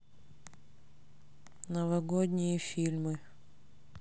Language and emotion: Russian, neutral